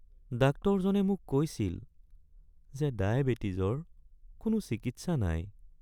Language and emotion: Assamese, sad